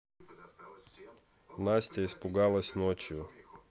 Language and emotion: Russian, neutral